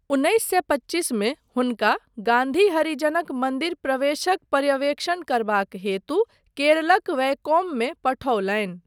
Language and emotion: Maithili, neutral